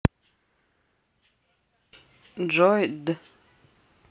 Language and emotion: Russian, neutral